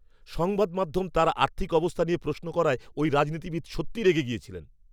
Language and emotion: Bengali, angry